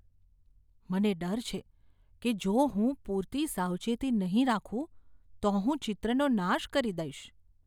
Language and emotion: Gujarati, fearful